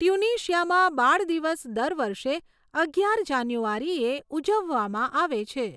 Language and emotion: Gujarati, neutral